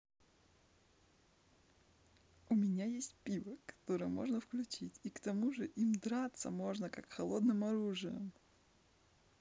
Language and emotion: Russian, positive